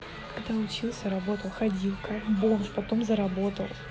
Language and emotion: Russian, neutral